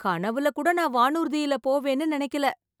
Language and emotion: Tamil, happy